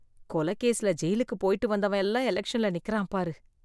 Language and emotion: Tamil, disgusted